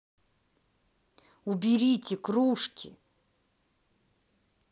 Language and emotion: Russian, angry